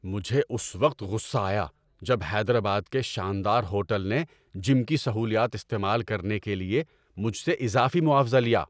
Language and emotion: Urdu, angry